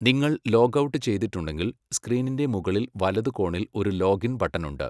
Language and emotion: Malayalam, neutral